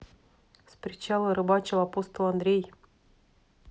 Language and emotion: Russian, neutral